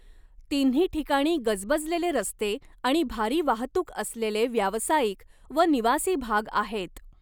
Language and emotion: Marathi, neutral